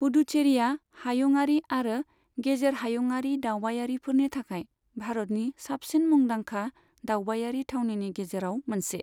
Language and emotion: Bodo, neutral